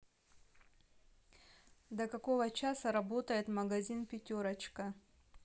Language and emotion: Russian, neutral